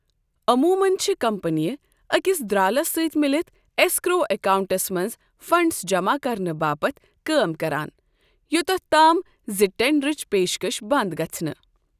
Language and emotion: Kashmiri, neutral